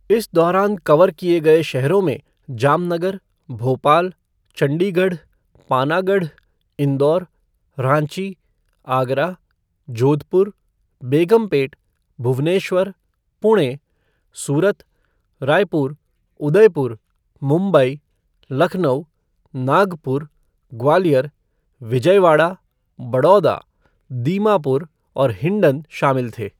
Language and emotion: Hindi, neutral